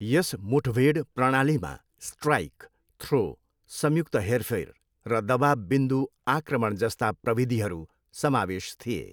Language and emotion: Nepali, neutral